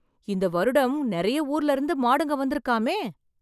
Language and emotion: Tamil, surprised